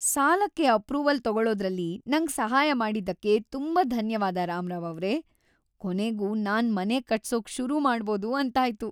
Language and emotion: Kannada, happy